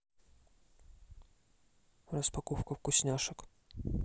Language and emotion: Russian, neutral